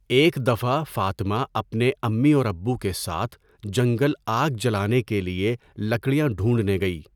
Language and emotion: Urdu, neutral